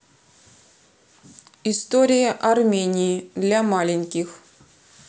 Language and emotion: Russian, neutral